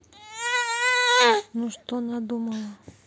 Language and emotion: Russian, neutral